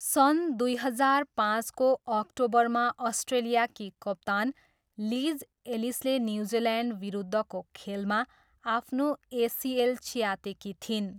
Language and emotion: Nepali, neutral